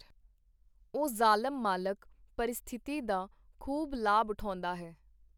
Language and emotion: Punjabi, neutral